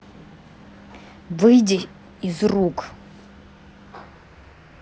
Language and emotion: Russian, angry